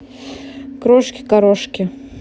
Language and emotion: Russian, neutral